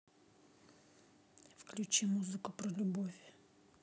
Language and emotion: Russian, neutral